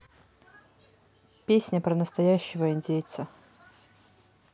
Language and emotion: Russian, neutral